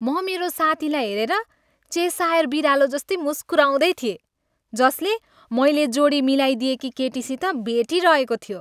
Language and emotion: Nepali, happy